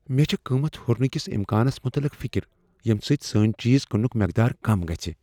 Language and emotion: Kashmiri, fearful